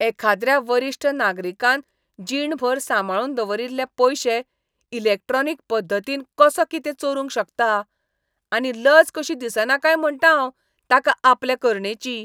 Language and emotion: Goan Konkani, disgusted